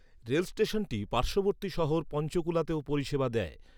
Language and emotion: Bengali, neutral